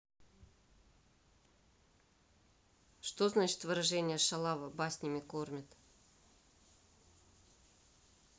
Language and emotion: Russian, neutral